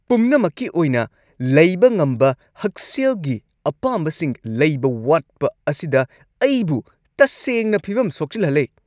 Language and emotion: Manipuri, angry